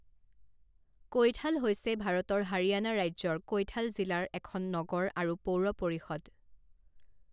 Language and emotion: Assamese, neutral